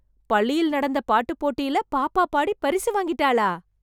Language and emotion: Tamil, surprised